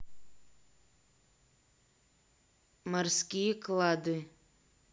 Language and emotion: Russian, neutral